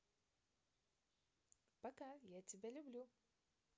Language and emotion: Russian, positive